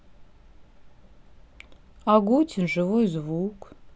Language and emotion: Russian, neutral